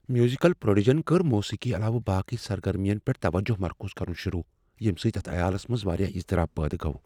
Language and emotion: Kashmiri, fearful